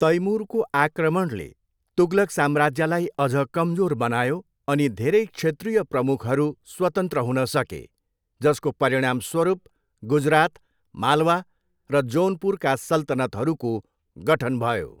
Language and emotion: Nepali, neutral